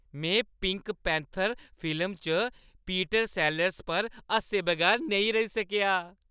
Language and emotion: Dogri, happy